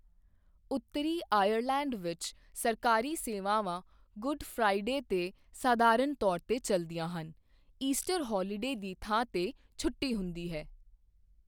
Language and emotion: Punjabi, neutral